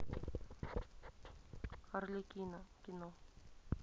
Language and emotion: Russian, neutral